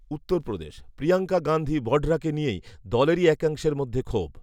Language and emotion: Bengali, neutral